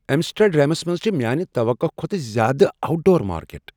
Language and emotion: Kashmiri, surprised